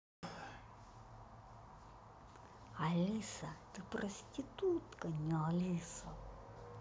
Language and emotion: Russian, neutral